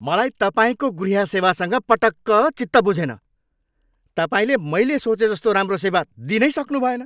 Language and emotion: Nepali, angry